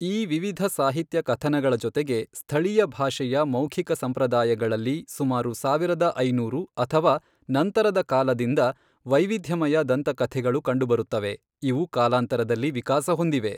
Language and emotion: Kannada, neutral